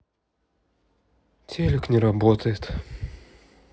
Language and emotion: Russian, sad